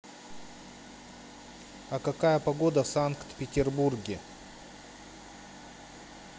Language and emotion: Russian, neutral